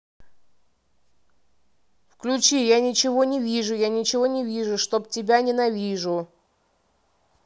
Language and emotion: Russian, neutral